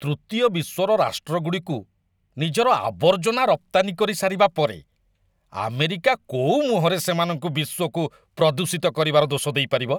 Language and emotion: Odia, disgusted